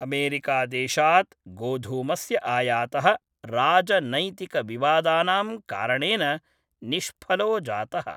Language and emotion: Sanskrit, neutral